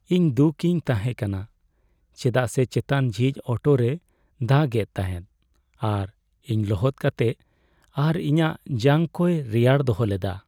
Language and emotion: Santali, sad